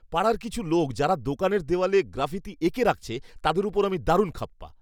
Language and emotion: Bengali, angry